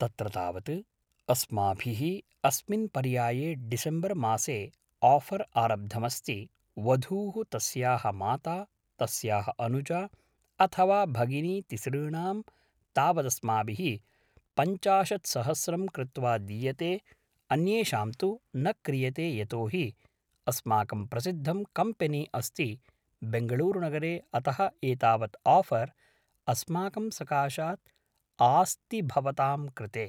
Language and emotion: Sanskrit, neutral